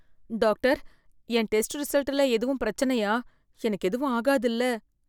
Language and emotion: Tamil, fearful